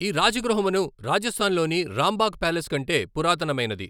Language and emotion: Telugu, neutral